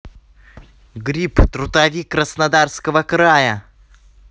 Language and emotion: Russian, positive